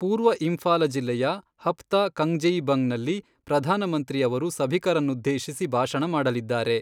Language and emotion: Kannada, neutral